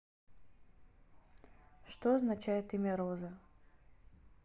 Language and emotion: Russian, neutral